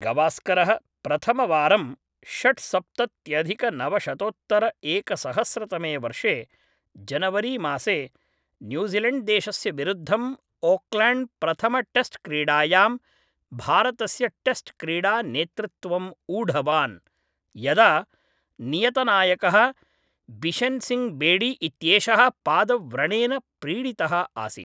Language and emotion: Sanskrit, neutral